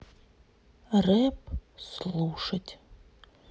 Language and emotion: Russian, sad